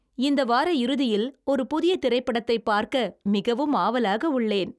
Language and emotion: Tamil, happy